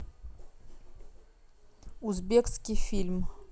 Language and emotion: Russian, neutral